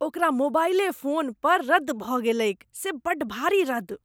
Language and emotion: Maithili, disgusted